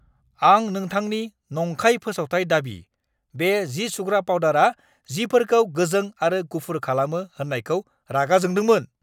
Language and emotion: Bodo, angry